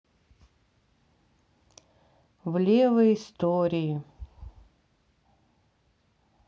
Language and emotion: Russian, sad